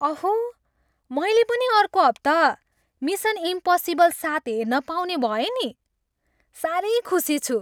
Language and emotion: Nepali, happy